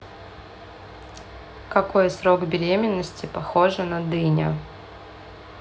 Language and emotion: Russian, neutral